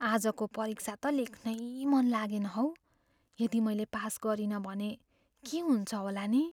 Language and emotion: Nepali, fearful